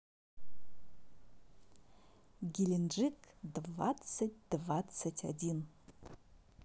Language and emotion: Russian, positive